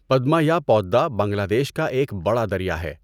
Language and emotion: Urdu, neutral